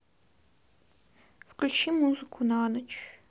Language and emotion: Russian, neutral